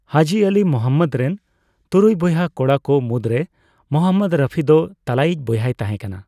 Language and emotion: Santali, neutral